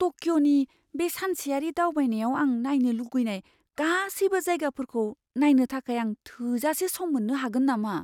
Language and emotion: Bodo, fearful